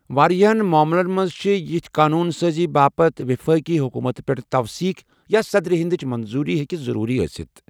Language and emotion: Kashmiri, neutral